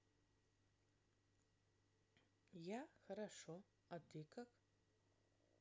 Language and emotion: Russian, neutral